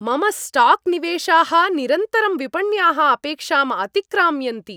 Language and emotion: Sanskrit, happy